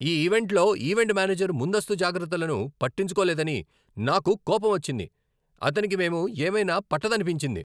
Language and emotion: Telugu, angry